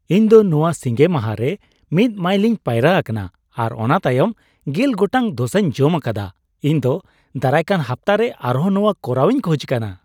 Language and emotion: Santali, happy